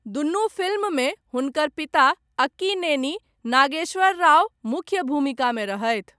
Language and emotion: Maithili, neutral